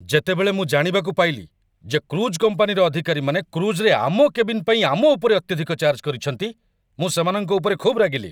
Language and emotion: Odia, angry